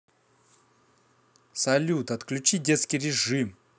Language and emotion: Russian, angry